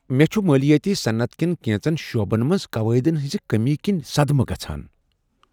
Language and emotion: Kashmiri, surprised